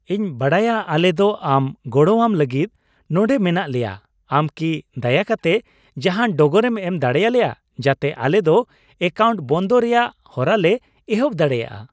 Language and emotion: Santali, happy